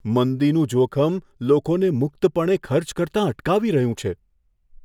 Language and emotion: Gujarati, fearful